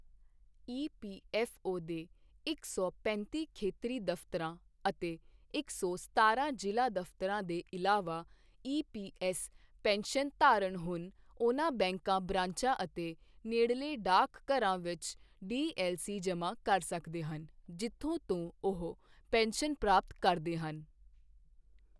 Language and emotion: Punjabi, neutral